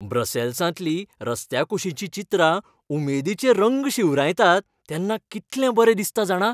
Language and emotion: Goan Konkani, happy